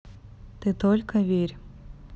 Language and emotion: Russian, neutral